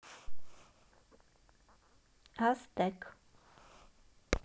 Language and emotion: Russian, positive